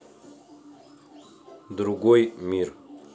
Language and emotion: Russian, neutral